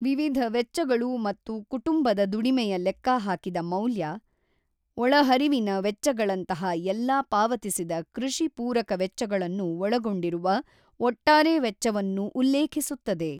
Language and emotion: Kannada, neutral